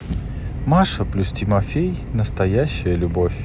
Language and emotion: Russian, neutral